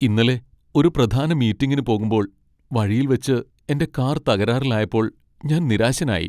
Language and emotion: Malayalam, sad